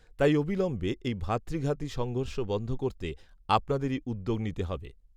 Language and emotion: Bengali, neutral